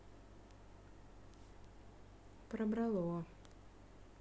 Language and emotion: Russian, neutral